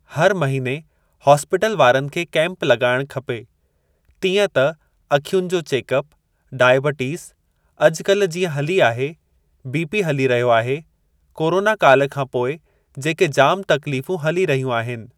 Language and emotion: Sindhi, neutral